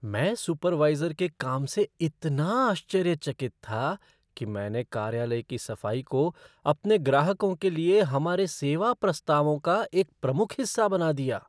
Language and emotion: Hindi, surprised